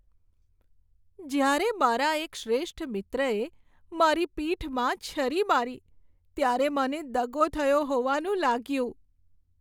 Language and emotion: Gujarati, sad